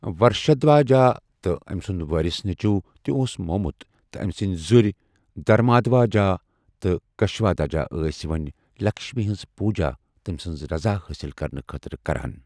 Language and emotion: Kashmiri, neutral